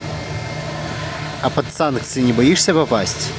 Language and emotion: Russian, positive